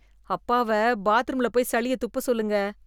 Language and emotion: Tamil, disgusted